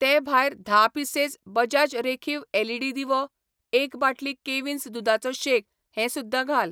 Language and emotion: Goan Konkani, neutral